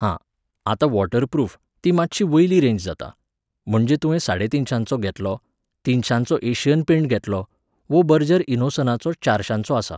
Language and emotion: Goan Konkani, neutral